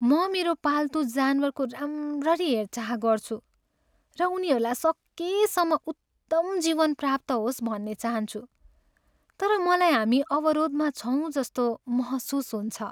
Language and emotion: Nepali, sad